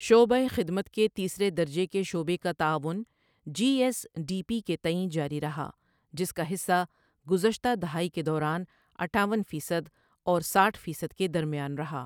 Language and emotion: Urdu, neutral